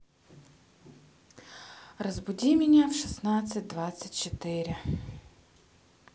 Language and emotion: Russian, neutral